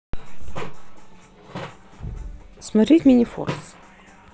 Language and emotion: Russian, neutral